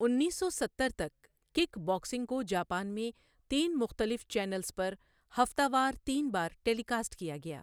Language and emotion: Urdu, neutral